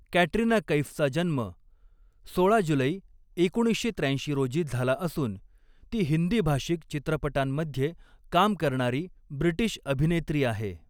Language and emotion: Marathi, neutral